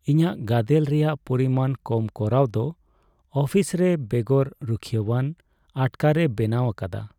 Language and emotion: Santali, sad